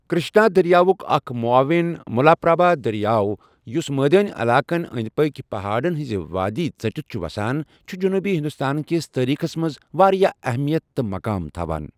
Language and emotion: Kashmiri, neutral